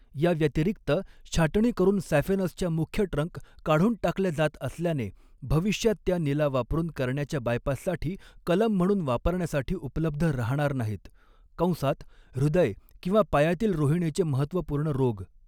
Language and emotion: Marathi, neutral